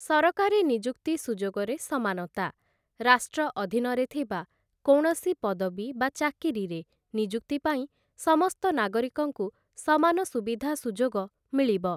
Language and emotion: Odia, neutral